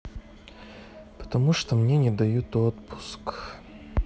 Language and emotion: Russian, sad